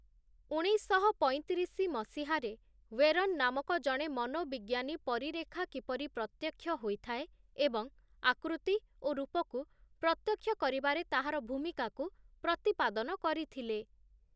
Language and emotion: Odia, neutral